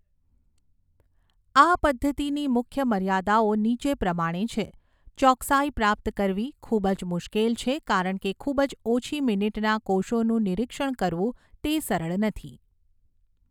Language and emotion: Gujarati, neutral